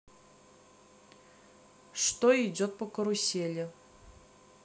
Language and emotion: Russian, neutral